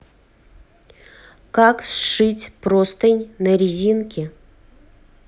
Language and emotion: Russian, neutral